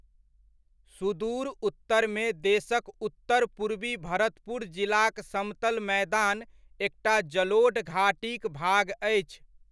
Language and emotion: Maithili, neutral